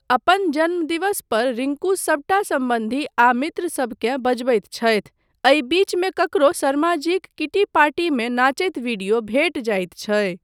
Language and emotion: Maithili, neutral